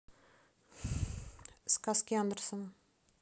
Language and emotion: Russian, neutral